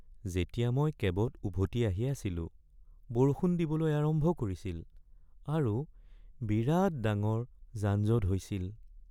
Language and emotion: Assamese, sad